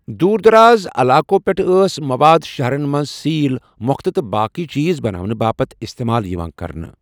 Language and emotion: Kashmiri, neutral